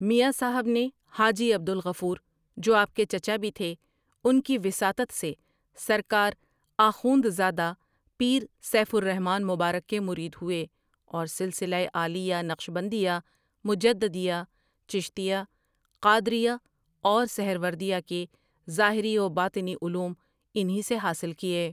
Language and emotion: Urdu, neutral